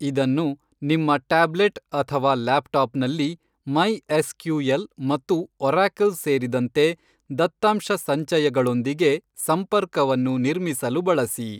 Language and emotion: Kannada, neutral